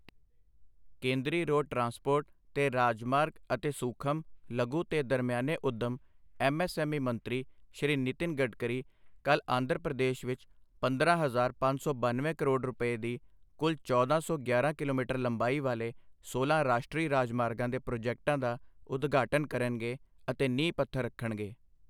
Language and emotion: Punjabi, neutral